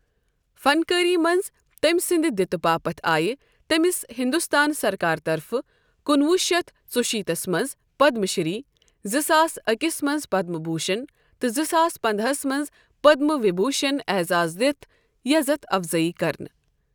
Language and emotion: Kashmiri, neutral